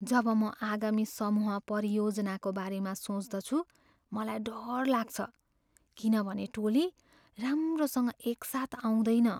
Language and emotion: Nepali, fearful